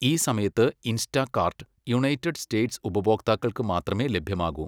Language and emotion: Malayalam, neutral